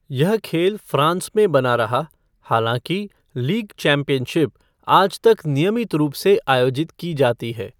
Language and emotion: Hindi, neutral